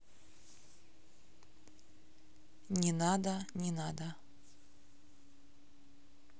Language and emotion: Russian, neutral